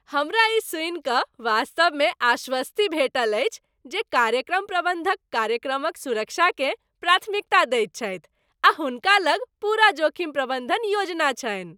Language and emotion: Maithili, happy